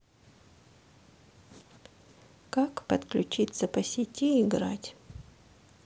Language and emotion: Russian, sad